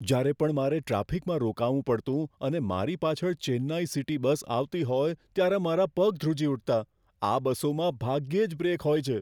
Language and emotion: Gujarati, fearful